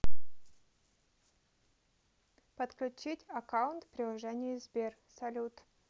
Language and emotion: Russian, neutral